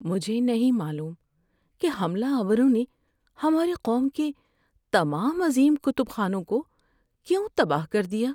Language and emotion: Urdu, sad